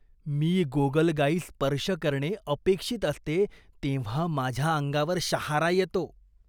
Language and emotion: Marathi, disgusted